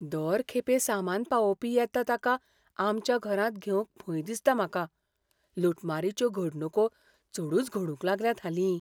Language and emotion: Goan Konkani, fearful